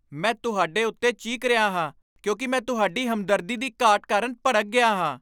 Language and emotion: Punjabi, angry